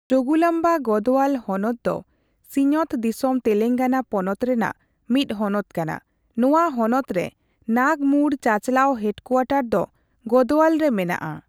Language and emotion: Santali, neutral